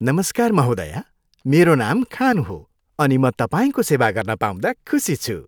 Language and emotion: Nepali, happy